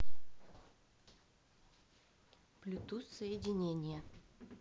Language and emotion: Russian, neutral